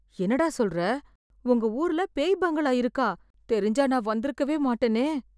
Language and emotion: Tamil, fearful